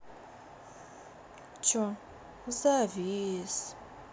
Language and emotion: Russian, sad